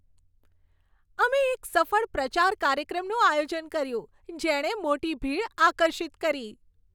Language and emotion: Gujarati, happy